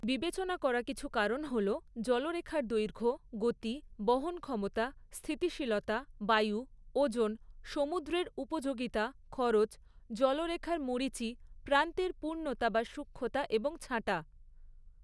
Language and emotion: Bengali, neutral